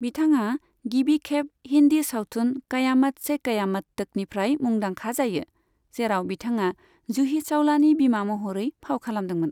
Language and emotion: Bodo, neutral